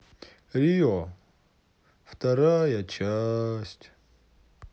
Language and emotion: Russian, sad